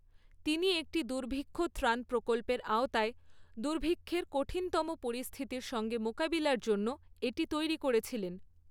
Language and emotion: Bengali, neutral